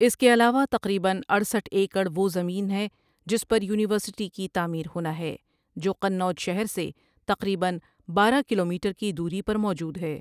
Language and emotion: Urdu, neutral